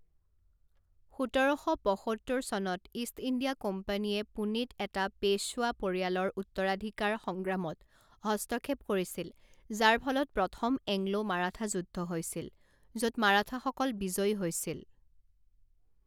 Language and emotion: Assamese, neutral